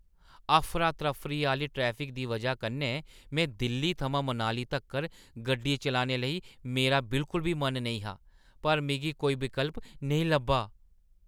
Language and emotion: Dogri, disgusted